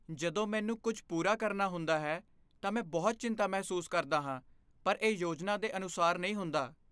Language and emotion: Punjabi, fearful